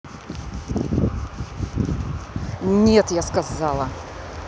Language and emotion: Russian, angry